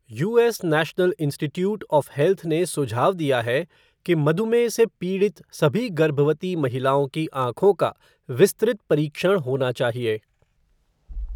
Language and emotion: Hindi, neutral